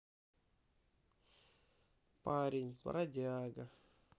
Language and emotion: Russian, sad